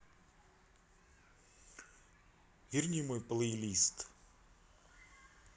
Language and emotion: Russian, neutral